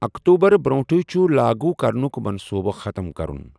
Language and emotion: Kashmiri, neutral